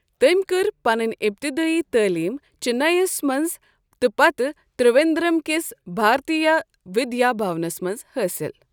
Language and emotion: Kashmiri, neutral